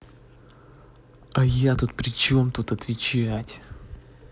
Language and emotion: Russian, angry